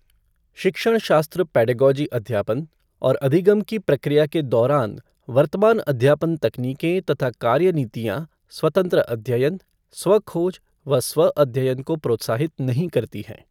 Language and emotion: Hindi, neutral